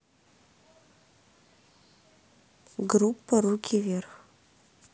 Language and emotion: Russian, neutral